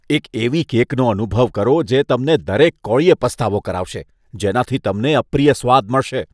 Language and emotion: Gujarati, disgusted